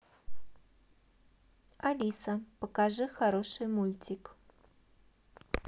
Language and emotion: Russian, neutral